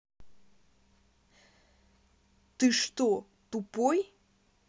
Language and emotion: Russian, angry